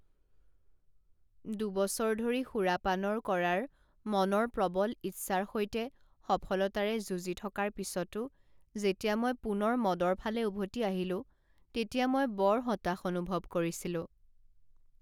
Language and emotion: Assamese, sad